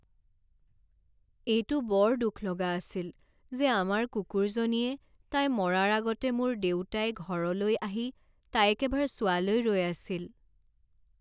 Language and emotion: Assamese, sad